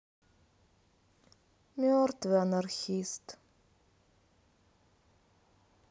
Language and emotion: Russian, sad